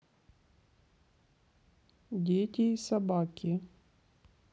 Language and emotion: Russian, neutral